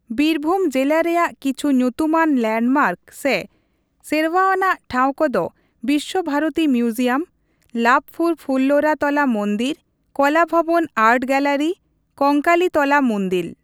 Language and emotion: Santali, neutral